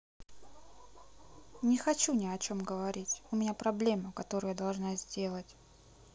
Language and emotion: Russian, sad